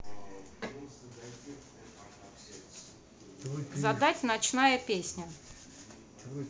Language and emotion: Russian, neutral